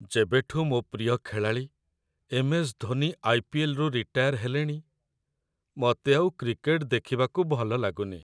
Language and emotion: Odia, sad